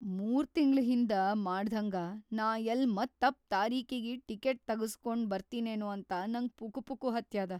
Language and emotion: Kannada, fearful